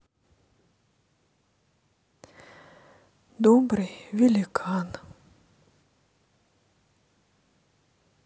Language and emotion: Russian, sad